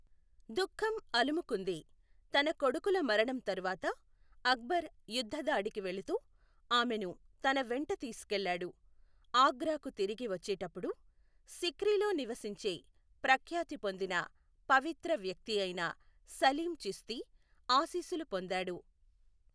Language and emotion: Telugu, neutral